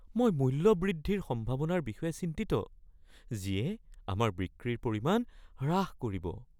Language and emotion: Assamese, fearful